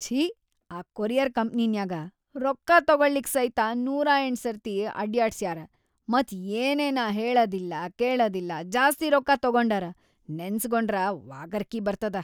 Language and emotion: Kannada, disgusted